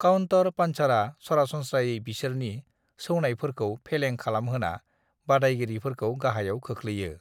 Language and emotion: Bodo, neutral